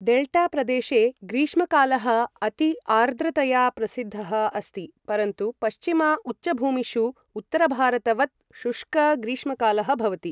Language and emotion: Sanskrit, neutral